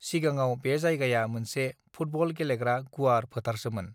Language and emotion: Bodo, neutral